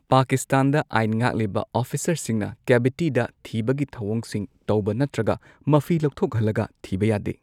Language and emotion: Manipuri, neutral